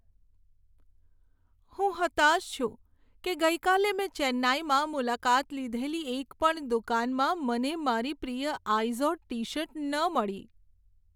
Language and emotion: Gujarati, sad